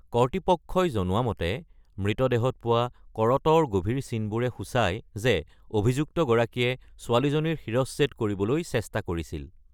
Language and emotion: Assamese, neutral